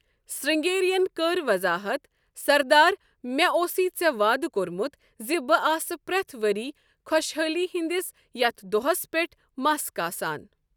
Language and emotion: Kashmiri, neutral